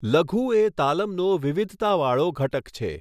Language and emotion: Gujarati, neutral